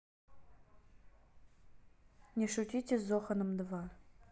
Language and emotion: Russian, neutral